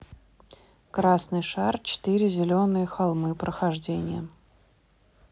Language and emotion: Russian, neutral